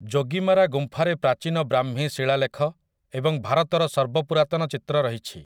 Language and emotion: Odia, neutral